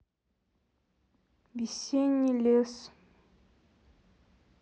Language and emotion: Russian, neutral